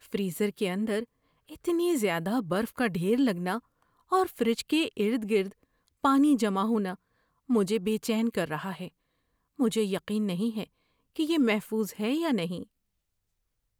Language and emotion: Urdu, fearful